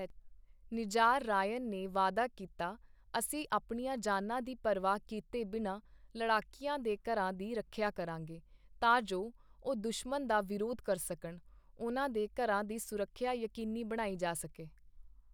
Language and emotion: Punjabi, neutral